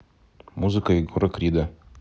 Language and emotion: Russian, neutral